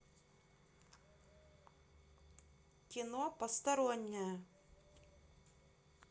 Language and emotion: Russian, neutral